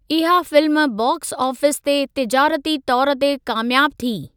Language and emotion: Sindhi, neutral